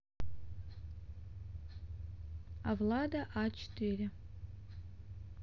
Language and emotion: Russian, neutral